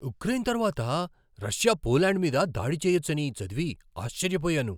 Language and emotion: Telugu, surprised